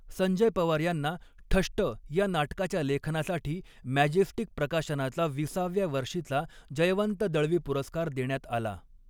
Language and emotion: Marathi, neutral